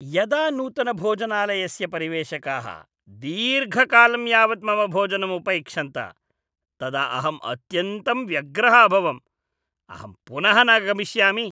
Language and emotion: Sanskrit, disgusted